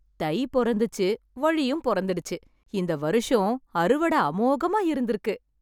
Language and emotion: Tamil, happy